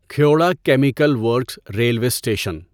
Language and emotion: Urdu, neutral